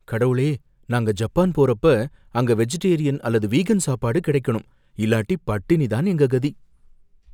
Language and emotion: Tamil, fearful